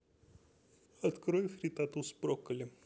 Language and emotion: Russian, neutral